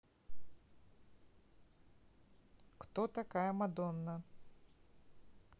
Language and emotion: Russian, neutral